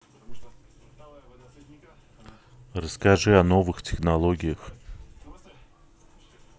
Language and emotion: Russian, neutral